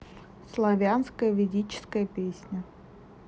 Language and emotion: Russian, neutral